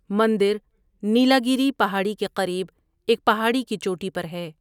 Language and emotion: Urdu, neutral